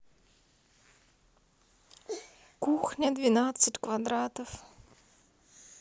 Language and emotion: Russian, sad